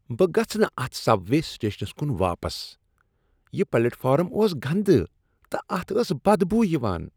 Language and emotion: Kashmiri, disgusted